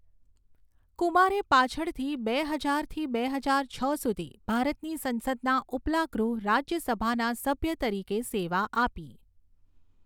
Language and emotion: Gujarati, neutral